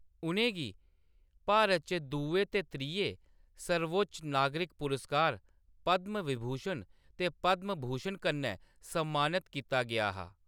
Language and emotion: Dogri, neutral